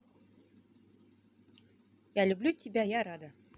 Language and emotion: Russian, positive